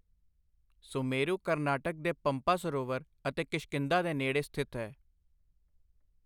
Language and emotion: Punjabi, neutral